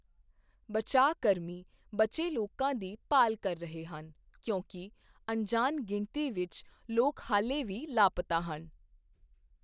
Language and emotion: Punjabi, neutral